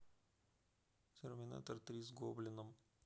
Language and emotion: Russian, neutral